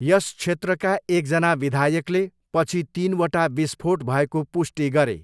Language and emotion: Nepali, neutral